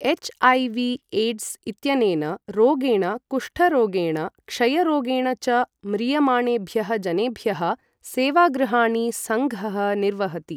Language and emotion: Sanskrit, neutral